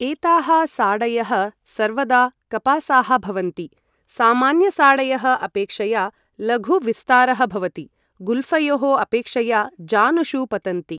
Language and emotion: Sanskrit, neutral